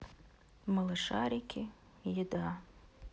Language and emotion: Russian, sad